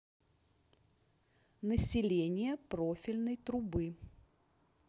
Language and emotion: Russian, neutral